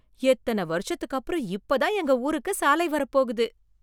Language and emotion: Tamil, surprised